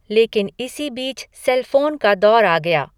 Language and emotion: Hindi, neutral